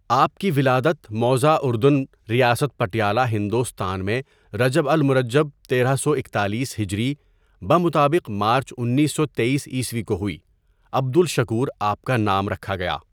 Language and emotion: Urdu, neutral